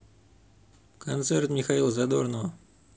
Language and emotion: Russian, neutral